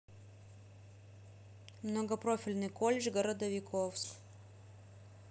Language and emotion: Russian, neutral